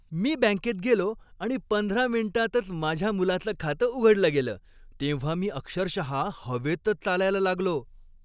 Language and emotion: Marathi, happy